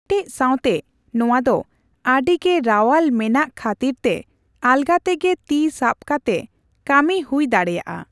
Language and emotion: Santali, neutral